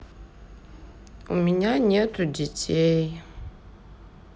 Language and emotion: Russian, sad